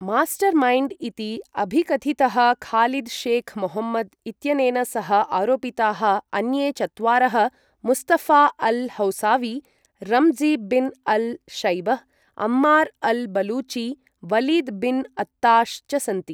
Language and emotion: Sanskrit, neutral